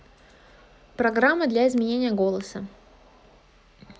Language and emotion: Russian, neutral